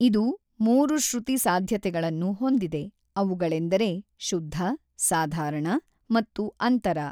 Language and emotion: Kannada, neutral